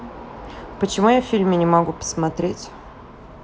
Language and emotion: Russian, neutral